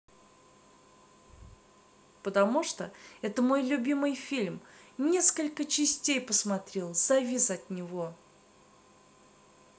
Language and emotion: Russian, positive